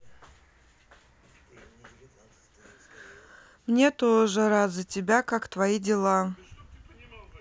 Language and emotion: Russian, sad